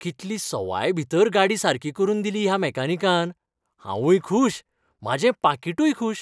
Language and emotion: Goan Konkani, happy